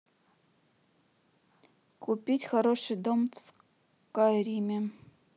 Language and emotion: Russian, neutral